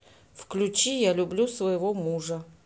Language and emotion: Russian, neutral